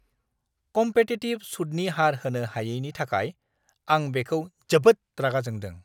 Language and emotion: Bodo, angry